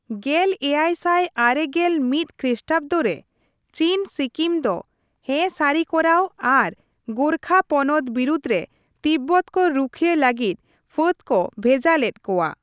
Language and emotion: Santali, neutral